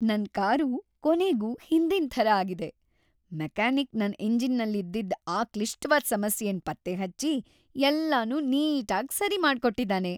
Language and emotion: Kannada, happy